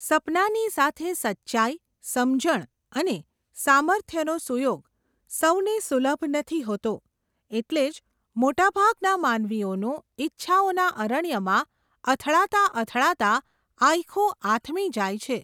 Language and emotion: Gujarati, neutral